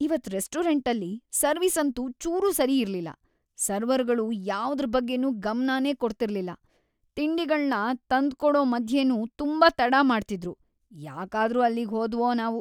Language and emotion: Kannada, disgusted